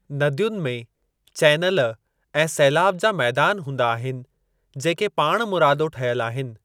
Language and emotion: Sindhi, neutral